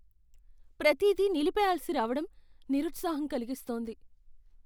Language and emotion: Telugu, fearful